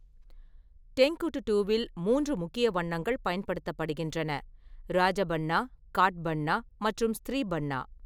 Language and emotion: Tamil, neutral